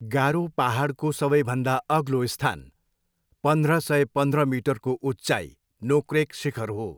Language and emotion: Nepali, neutral